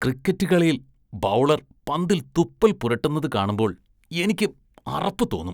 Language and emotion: Malayalam, disgusted